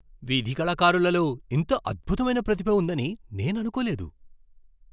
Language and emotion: Telugu, surprised